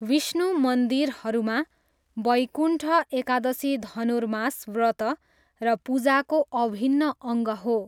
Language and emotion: Nepali, neutral